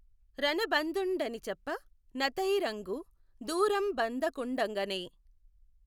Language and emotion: Telugu, neutral